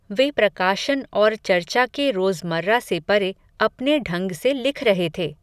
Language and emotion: Hindi, neutral